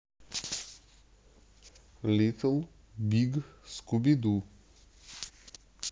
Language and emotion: Russian, neutral